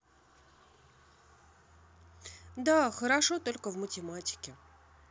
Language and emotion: Russian, sad